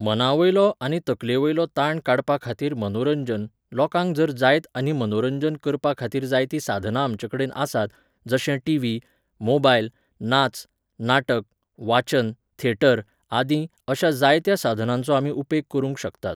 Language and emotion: Goan Konkani, neutral